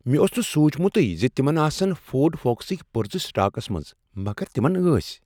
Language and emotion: Kashmiri, surprised